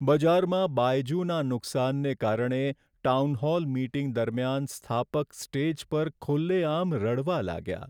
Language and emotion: Gujarati, sad